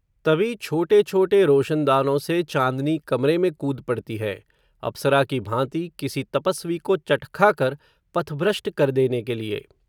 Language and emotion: Hindi, neutral